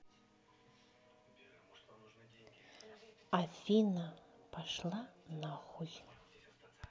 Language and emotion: Russian, neutral